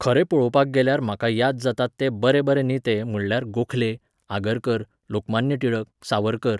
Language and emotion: Goan Konkani, neutral